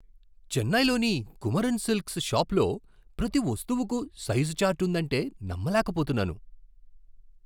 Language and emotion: Telugu, surprised